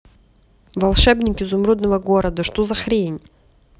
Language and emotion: Russian, angry